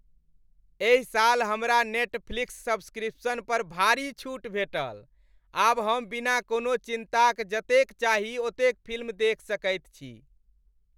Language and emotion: Maithili, happy